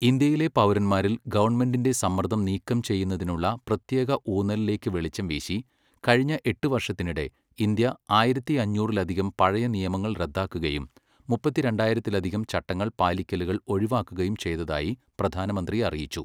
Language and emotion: Malayalam, neutral